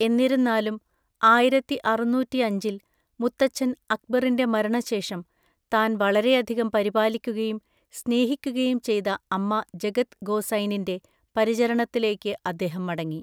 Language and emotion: Malayalam, neutral